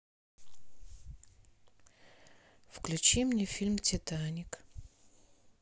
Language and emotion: Russian, sad